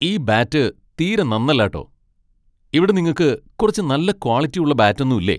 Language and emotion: Malayalam, angry